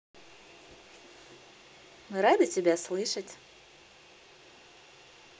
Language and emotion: Russian, positive